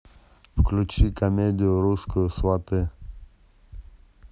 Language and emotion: Russian, neutral